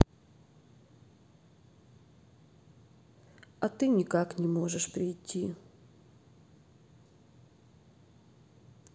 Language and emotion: Russian, sad